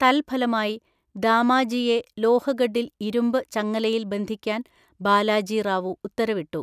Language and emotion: Malayalam, neutral